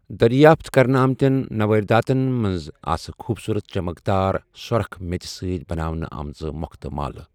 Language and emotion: Kashmiri, neutral